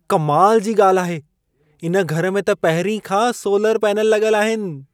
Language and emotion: Sindhi, surprised